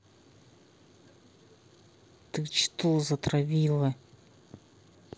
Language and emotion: Russian, angry